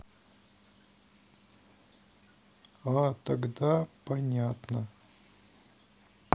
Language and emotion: Russian, sad